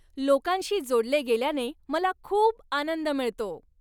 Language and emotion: Marathi, happy